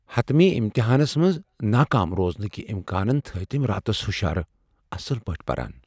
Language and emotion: Kashmiri, fearful